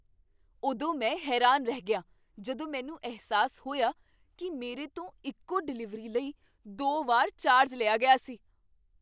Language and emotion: Punjabi, surprised